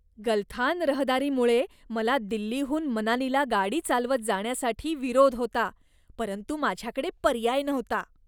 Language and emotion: Marathi, disgusted